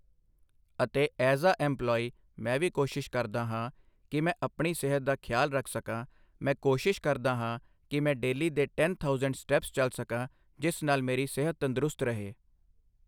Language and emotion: Punjabi, neutral